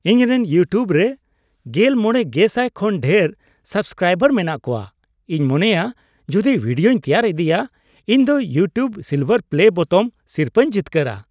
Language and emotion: Santali, happy